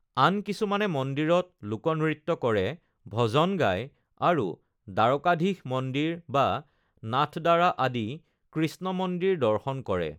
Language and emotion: Assamese, neutral